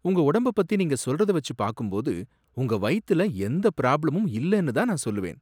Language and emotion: Tamil, surprised